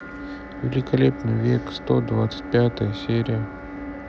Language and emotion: Russian, sad